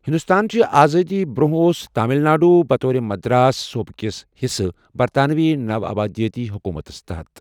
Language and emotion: Kashmiri, neutral